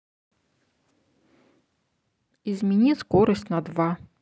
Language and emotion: Russian, neutral